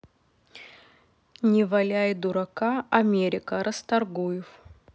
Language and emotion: Russian, neutral